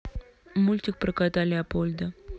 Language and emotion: Russian, neutral